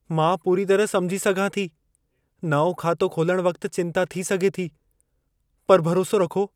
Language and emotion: Sindhi, fearful